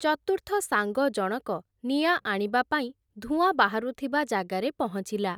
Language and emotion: Odia, neutral